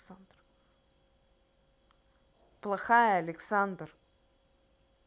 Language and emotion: Russian, angry